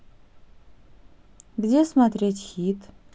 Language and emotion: Russian, neutral